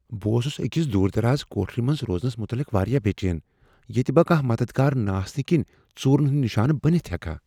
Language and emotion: Kashmiri, fearful